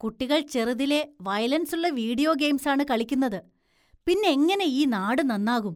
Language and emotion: Malayalam, disgusted